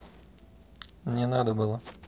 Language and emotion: Russian, neutral